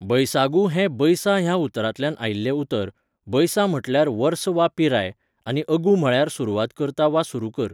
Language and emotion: Goan Konkani, neutral